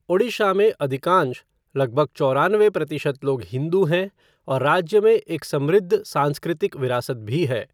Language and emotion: Hindi, neutral